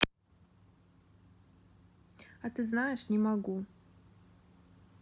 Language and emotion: Russian, neutral